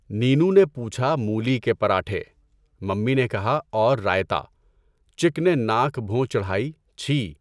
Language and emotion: Urdu, neutral